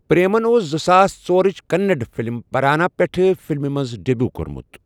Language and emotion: Kashmiri, neutral